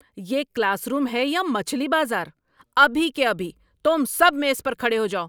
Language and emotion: Urdu, angry